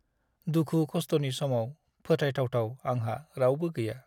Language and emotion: Bodo, sad